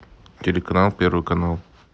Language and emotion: Russian, neutral